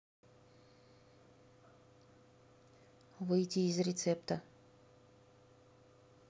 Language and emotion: Russian, neutral